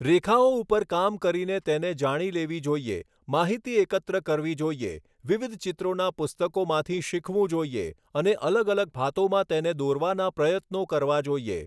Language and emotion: Gujarati, neutral